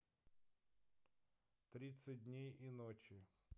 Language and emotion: Russian, neutral